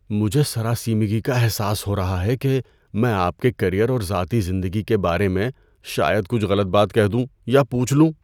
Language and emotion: Urdu, fearful